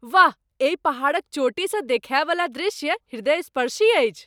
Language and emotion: Maithili, surprised